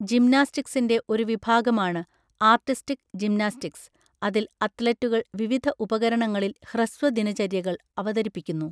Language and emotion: Malayalam, neutral